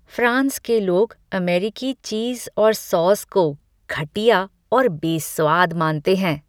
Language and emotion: Hindi, disgusted